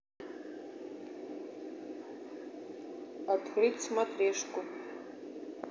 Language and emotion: Russian, neutral